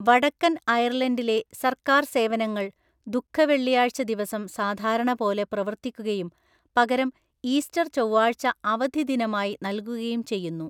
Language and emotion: Malayalam, neutral